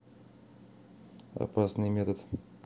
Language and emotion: Russian, neutral